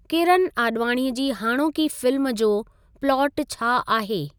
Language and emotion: Sindhi, neutral